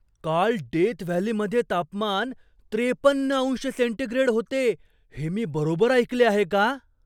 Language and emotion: Marathi, surprised